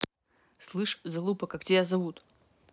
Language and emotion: Russian, angry